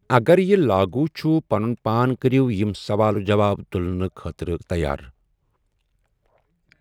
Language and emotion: Kashmiri, neutral